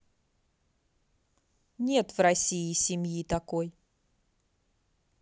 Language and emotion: Russian, positive